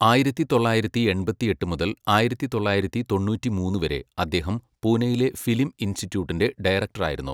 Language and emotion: Malayalam, neutral